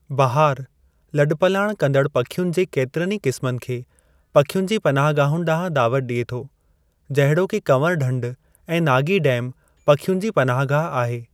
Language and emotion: Sindhi, neutral